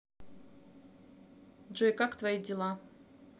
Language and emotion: Russian, neutral